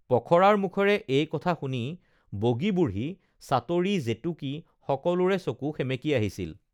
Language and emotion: Assamese, neutral